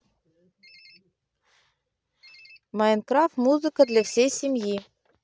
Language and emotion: Russian, neutral